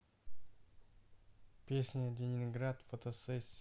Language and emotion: Russian, neutral